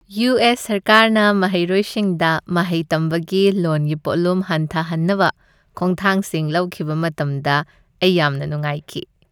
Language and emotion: Manipuri, happy